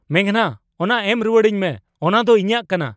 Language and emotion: Santali, angry